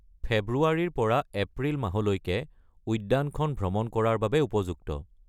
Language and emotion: Assamese, neutral